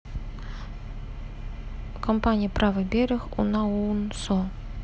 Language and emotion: Russian, neutral